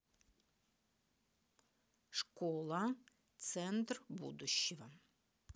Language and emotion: Russian, neutral